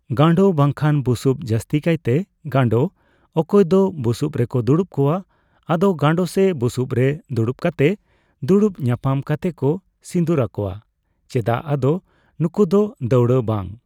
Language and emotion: Santali, neutral